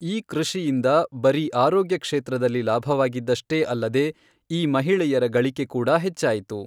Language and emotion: Kannada, neutral